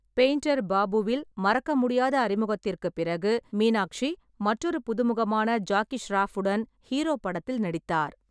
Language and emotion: Tamil, neutral